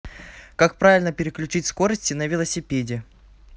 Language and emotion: Russian, neutral